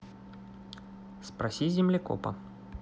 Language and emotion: Russian, neutral